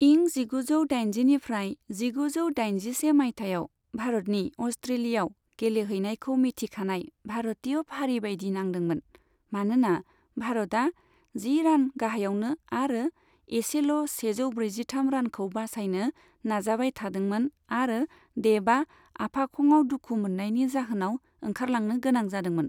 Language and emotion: Bodo, neutral